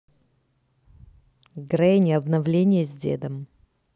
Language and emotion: Russian, neutral